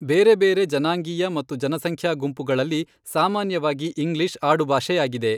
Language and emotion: Kannada, neutral